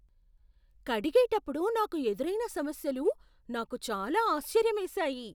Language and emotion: Telugu, surprised